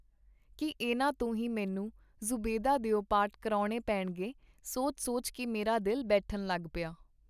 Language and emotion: Punjabi, neutral